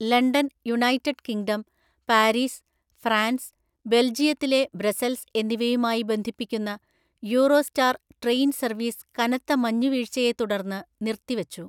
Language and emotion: Malayalam, neutral